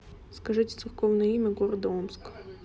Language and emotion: Russian, neutral